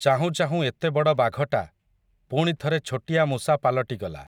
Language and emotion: Odia, neutral